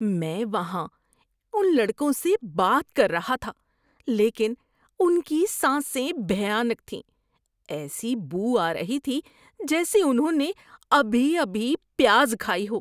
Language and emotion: Urdu, disgusted